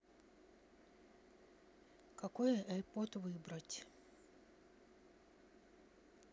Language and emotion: Russian, neutral